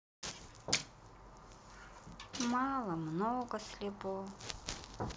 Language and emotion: Russian, sad